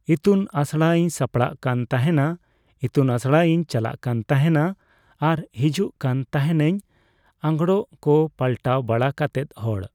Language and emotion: Santali, neutral